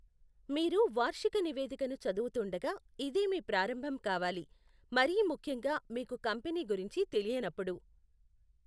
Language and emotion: Telugu, neutral